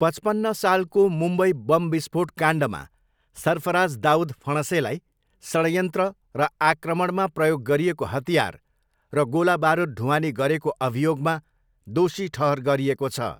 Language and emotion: Nepali, neutral